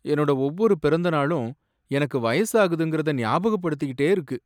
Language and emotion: Tamil, sad